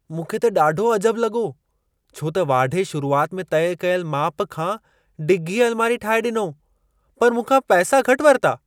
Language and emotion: Sindhi, surprised